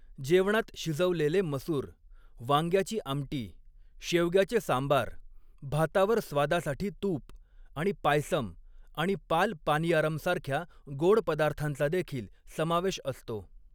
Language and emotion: Marathi, neutral